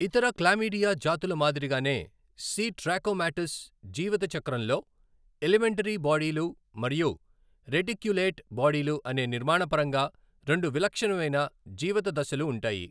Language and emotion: Telugu, neutral